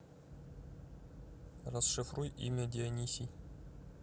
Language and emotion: Russian, neutral